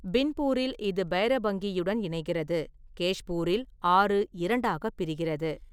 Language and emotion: Tamil, neutral